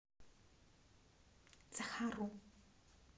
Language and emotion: Russian, neutral